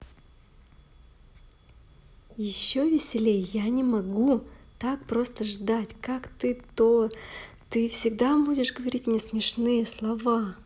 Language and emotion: Russian, positive